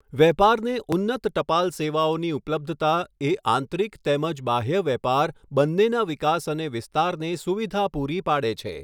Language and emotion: Gujarati, neutral